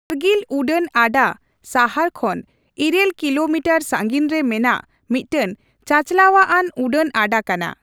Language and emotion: Santali, neutral